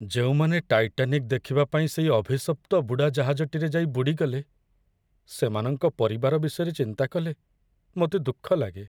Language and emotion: Odia, sad